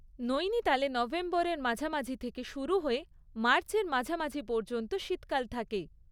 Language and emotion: Bengali, neutral